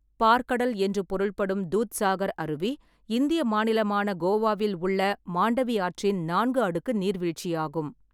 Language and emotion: Tamil, neutral